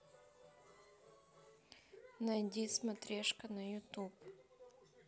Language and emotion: Russian, neutral